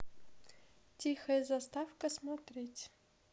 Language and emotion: Russian, neutral